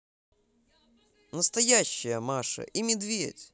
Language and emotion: Russian, positive